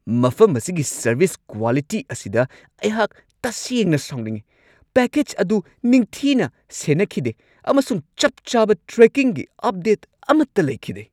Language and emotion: Manipuri, angry